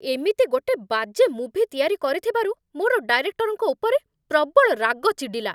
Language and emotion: Odia, angry